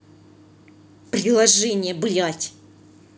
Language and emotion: Russian, angry